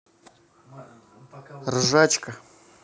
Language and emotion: Russian, neutral